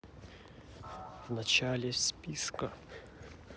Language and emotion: Russian, neutral